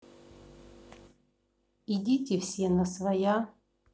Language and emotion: Russian, neutral